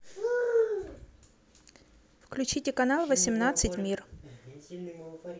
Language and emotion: Russian, neutral